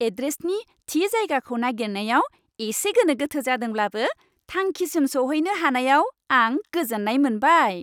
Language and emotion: Bodo, happy